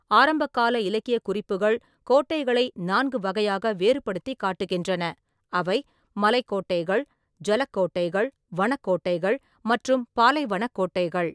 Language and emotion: Tamil, neutral